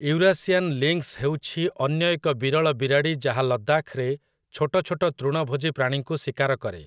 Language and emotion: Odia, neutral